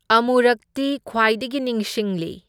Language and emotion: Manipuri, neutral